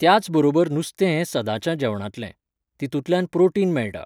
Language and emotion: Goan Konkani, neutral